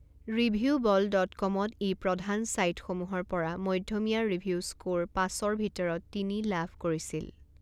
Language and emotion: Assamese, neutral